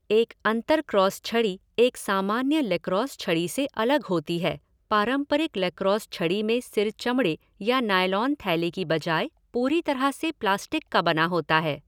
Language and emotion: Hindi, neutral